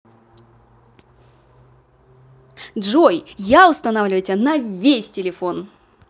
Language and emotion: Russian, positive